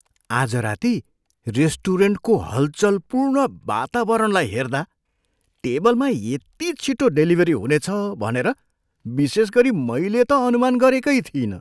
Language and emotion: Nepali, surprised